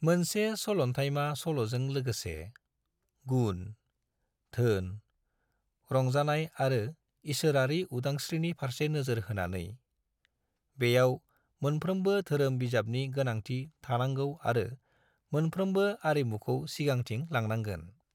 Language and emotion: Bodo, neutral